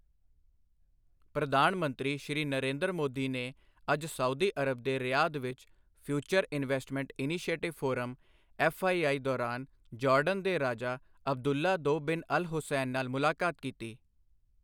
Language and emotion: Punjabi, neutral